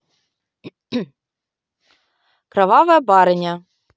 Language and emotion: Russian, neutral